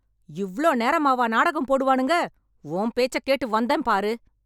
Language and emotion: Tamil, angry